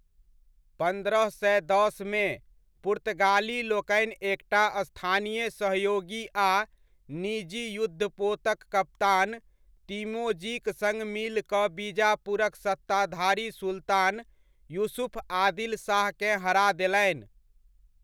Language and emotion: Maithili, neutral